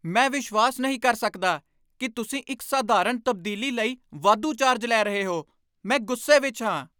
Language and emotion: Punjabi, angry